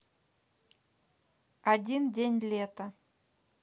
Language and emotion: Russian, neutral